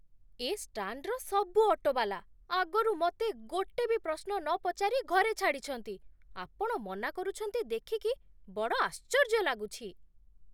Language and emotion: Odia, surprised